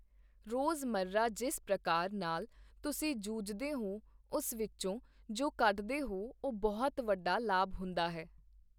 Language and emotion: Punjabi, neutral